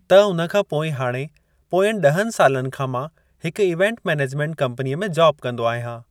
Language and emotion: Sindhi, neutral